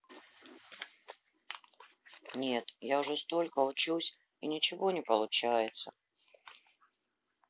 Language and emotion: Russian, sad